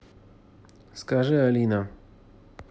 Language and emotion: Russian, neutral